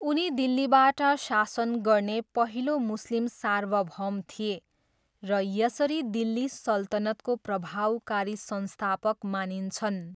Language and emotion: Nepali, neutral